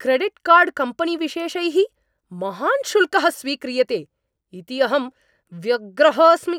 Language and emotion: Sanskrit, angry